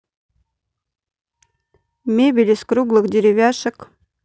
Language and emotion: Russian, neutral